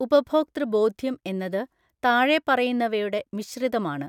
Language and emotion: Malayalam, neutral